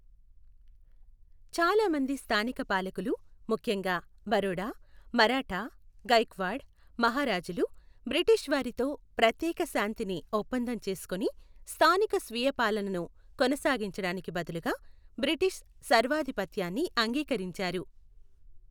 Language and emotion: Telugu, neutral